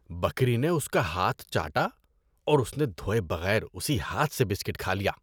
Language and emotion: Urdu, disgusted